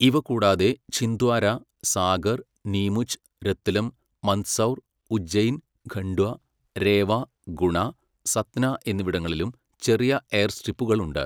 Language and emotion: Malayalam, neutral